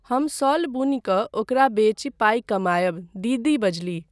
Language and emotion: Maithili, neutral